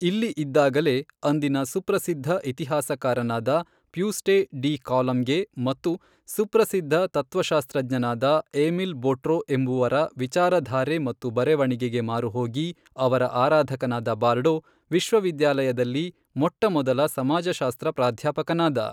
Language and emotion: Kannada, neutral